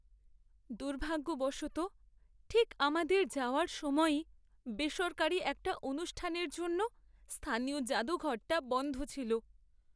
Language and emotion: Bengali, sad